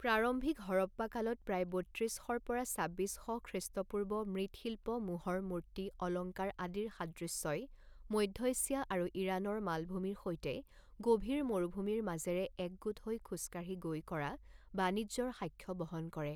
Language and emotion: Assamese, neutral